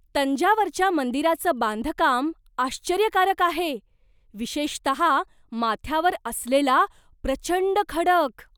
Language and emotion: Marathi, surprised